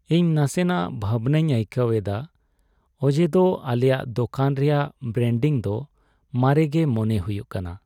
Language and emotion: Santali, sad